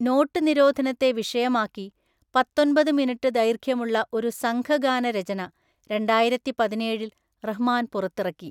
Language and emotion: Malayalam, neutral